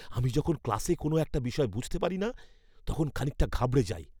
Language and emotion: Bengali, fearful